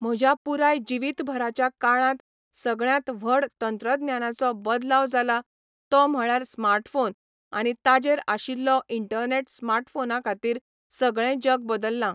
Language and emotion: Goan Konkani, neutral